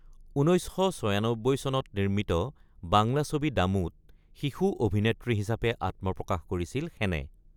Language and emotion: Assamese, neutral